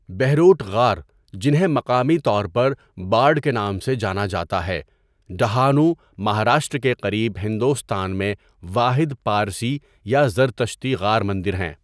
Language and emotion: Urdu, neutral